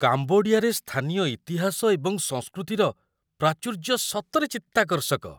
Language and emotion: Odia, surprised